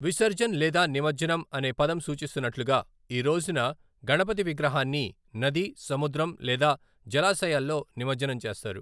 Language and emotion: Telugu, neutral